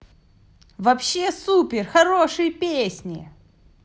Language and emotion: Russian, positive